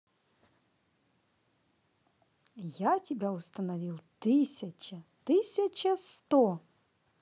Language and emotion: Russian, positive